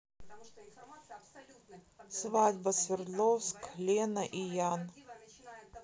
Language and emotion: Russian, neutral